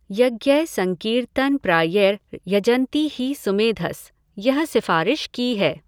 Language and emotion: Hindi, neutral